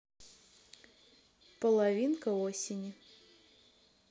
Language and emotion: Russian, neutral